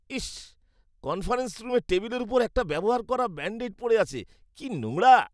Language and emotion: Bengali, disgusted